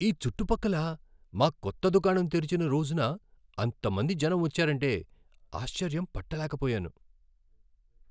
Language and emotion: Telugu, surprised